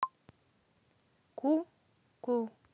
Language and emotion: Russian, neutral